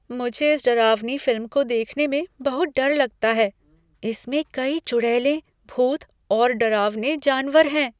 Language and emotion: Hindi, fearful